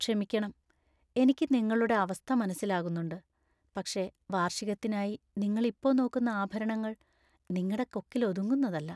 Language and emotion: Malayalam, sad